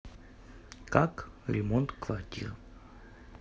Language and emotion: Russian, neutral